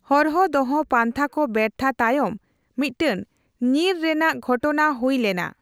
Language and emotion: Santali, neutral